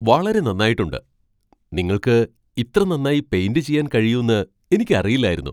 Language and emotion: Malayalam, surprised